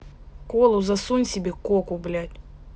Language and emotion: Russian, angry